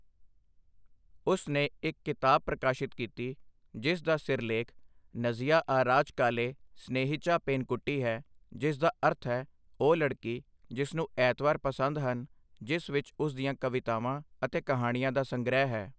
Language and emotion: Punjabi, neutral